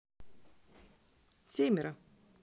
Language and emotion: Russian, neutral